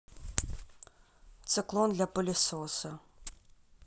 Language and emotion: Russian, neutral